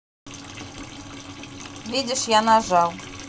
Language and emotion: Russian, neutral